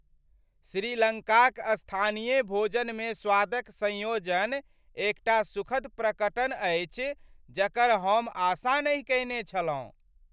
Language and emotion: Maithili, surprised